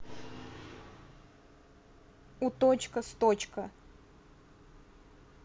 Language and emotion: Russian, neutral